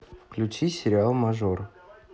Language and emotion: Russian, neutral